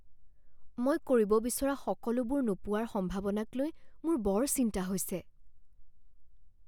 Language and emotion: Assamese, fearful